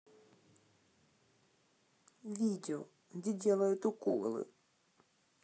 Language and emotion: Russian, sad